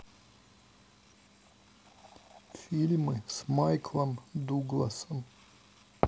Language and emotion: Russian, neutral